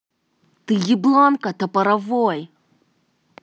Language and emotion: Russian, angry